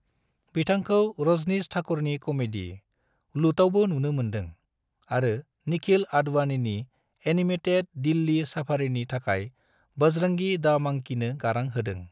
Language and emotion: Bodo, neutral